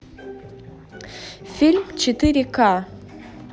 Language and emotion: Russian, neutral